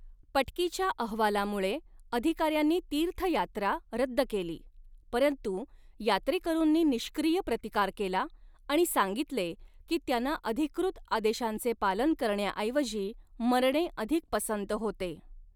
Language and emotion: Marathi, neutral